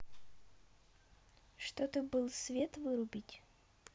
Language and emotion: Russian, neutral